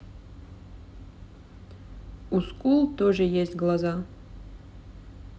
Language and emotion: Russian, neutral